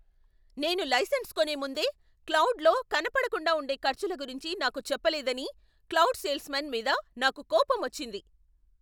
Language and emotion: Telugu, angry